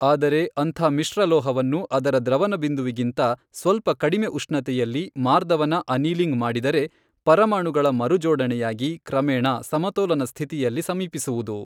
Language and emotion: Kannada, neutral